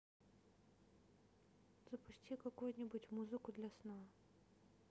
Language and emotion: Russian, neutral